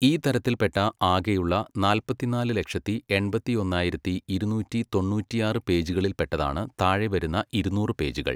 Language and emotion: Malayalam, neutral